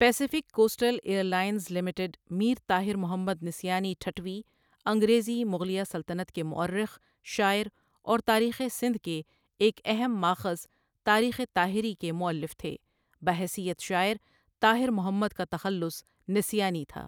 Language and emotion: Urdu, neutral